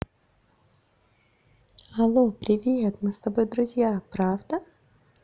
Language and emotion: Russian, positive